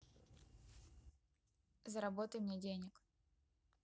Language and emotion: Russian, neutral